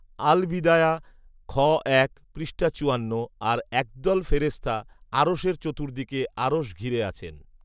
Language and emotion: Bengali, neutral